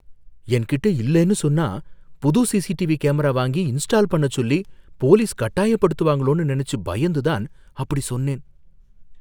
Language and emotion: Tamil, fearful